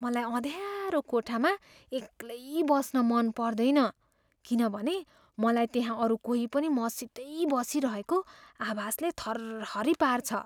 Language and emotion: Nepali, fearful